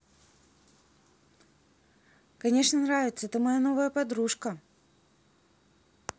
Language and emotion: Russian, positive